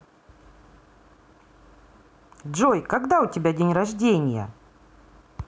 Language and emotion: Russian, positive